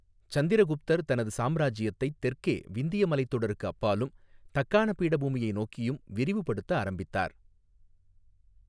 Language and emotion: Tamil, neutral